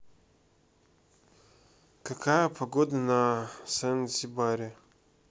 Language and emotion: Russian, neutral